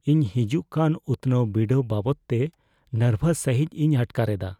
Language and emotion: Santali, fearful